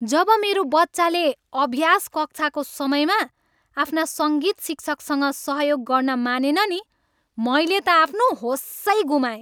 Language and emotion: Nepali, angry